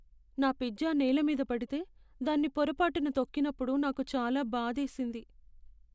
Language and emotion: Telugu, sad